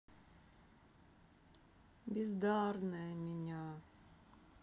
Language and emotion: Russian, sad